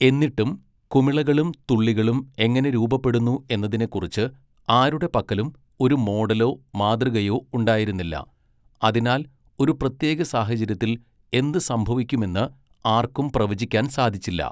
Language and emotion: Malayalam, neutral